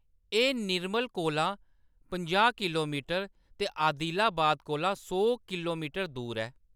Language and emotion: Dogri, neutral